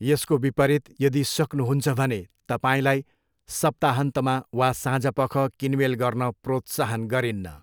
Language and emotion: Nepali, neutral